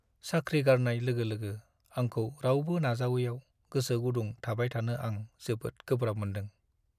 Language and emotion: Bodo, sad